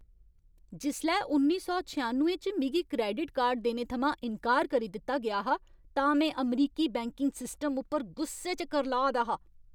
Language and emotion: Dogri, angry